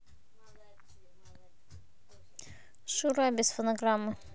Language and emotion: Russian, neutral